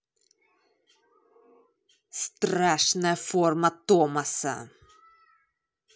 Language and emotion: Russian, angry